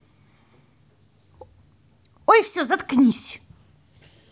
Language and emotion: Russian, angry